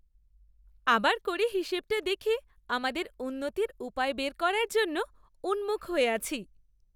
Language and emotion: Bengali, happy